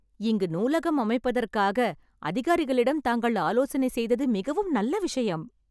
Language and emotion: Tamil, happy